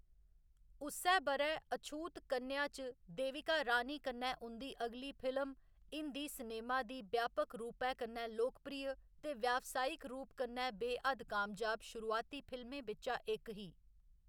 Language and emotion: Dogri, neutral